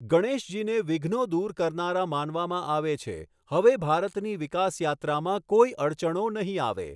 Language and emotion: Gujarati, neutral